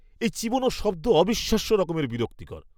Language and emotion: Bengali, disgusted